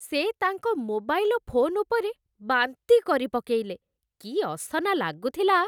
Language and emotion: Odia, disgusted